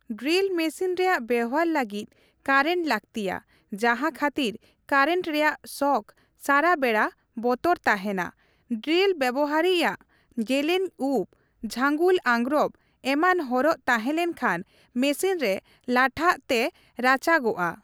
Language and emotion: Santali, neutral